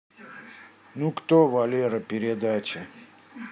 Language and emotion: Russian, sad